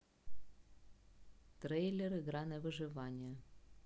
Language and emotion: Russian, neutral